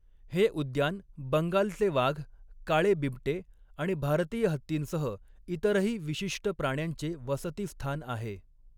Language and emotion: Marathi, neutral